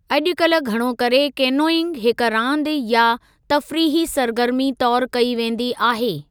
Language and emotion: Sindhi, neutral